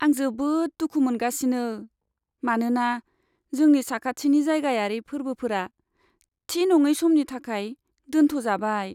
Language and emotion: Bodo, sad